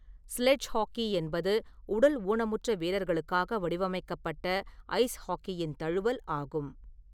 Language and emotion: Tamil, neutral